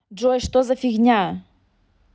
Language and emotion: Russian, angry